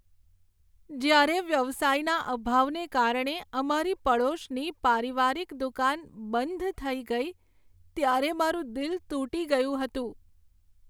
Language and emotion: Gujarati, sad